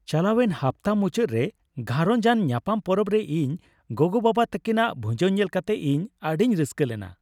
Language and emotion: Santali, happy